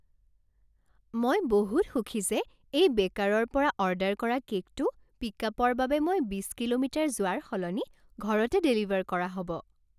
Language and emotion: Assamese, happy